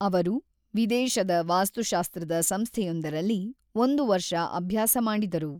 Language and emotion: Kannada, neutral